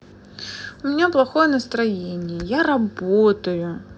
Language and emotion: Russian, sad